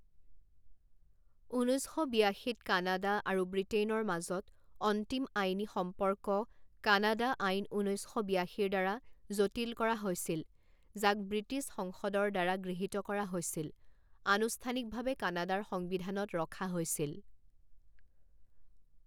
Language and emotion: Assamese, neutral